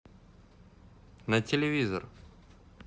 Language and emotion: Russian, neutral